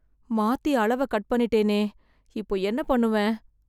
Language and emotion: Tamil, fearful